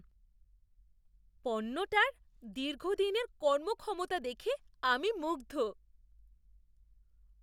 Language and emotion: Bengali, surprised